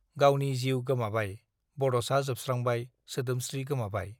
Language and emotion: Bodo, neutral